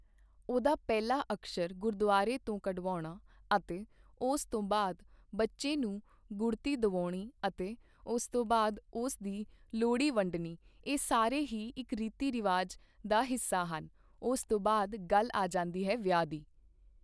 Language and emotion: Punjabi, neutral